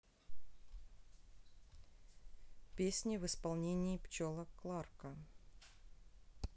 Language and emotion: Russian, neutral